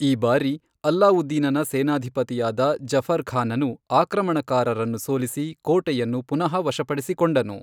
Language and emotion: Kannada, neutral